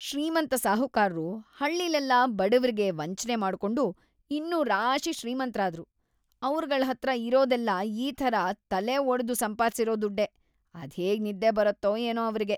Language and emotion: Kannada, disgusted